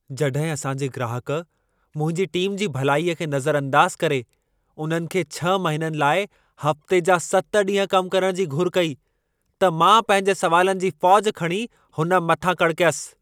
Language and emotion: Sindhi, angry